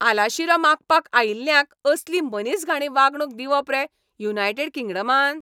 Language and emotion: Goan Konkani, angry